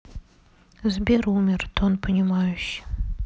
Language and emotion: Russian, sad